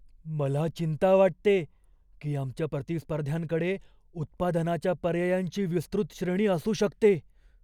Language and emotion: Marathi, fearful